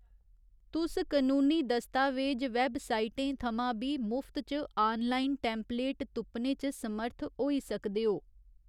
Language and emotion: Dogri, neutral